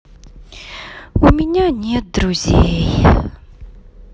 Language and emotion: Russian, sad